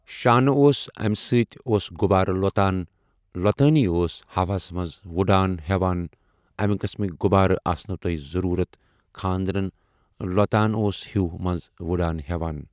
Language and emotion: Kashmiri, neutral